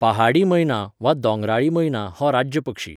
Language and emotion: Goan Konkani, neutral